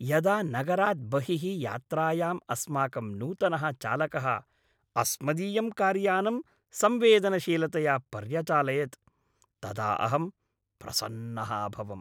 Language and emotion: Sanskrit, happy